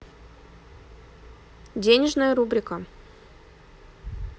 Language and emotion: Russian, neutral